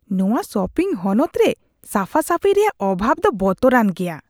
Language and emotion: Santali, disgusted